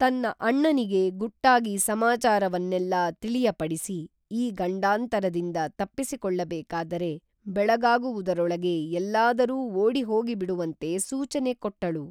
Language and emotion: Kannada, neutral